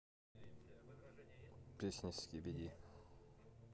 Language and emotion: Russian, neutral